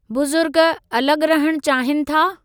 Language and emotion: Sindhi, neutral